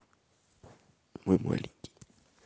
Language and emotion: Russian, positive